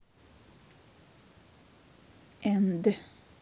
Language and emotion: Russian, neutral